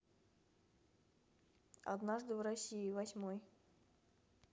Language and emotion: Russian, neutral